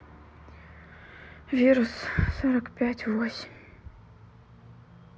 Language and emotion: Russian, sad